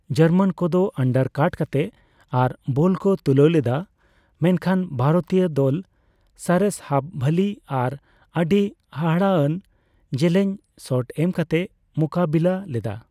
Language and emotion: Santali, neutral